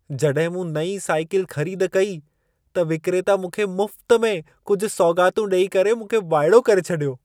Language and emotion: Sindhi, surprised